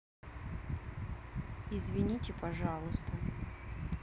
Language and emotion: Russian, sad